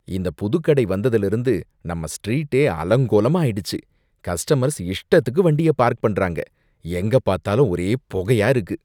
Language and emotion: Tamil, disgusted